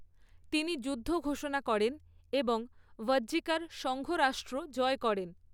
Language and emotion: Bengali, neutral